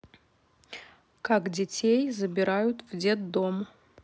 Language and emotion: Russian, neutral